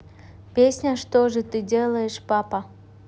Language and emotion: Russian, neutral